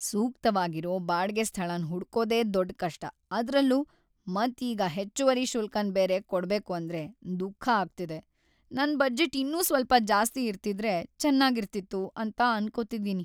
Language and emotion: Kannada, sad